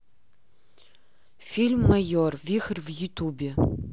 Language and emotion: Russian, neutral